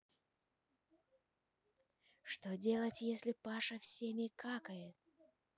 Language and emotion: Russian, neutral